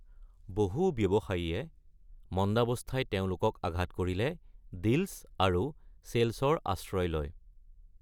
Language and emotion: Assamese, neutral